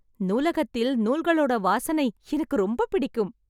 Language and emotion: Tamil, happy